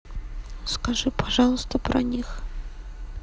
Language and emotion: Russian, sad